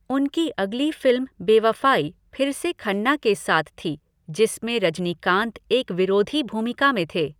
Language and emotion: Hindi, neutral